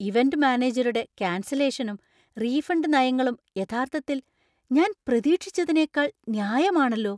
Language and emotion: Malayalam, surprised